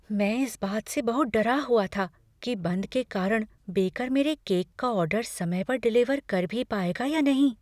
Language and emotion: Hindi, fearful